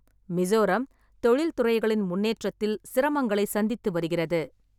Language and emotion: Tamil, neutral